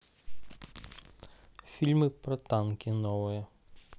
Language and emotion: Russian, neutral